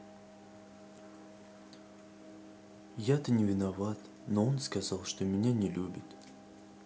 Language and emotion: Russian, sad